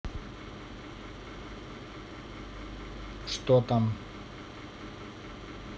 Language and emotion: Russian, neutral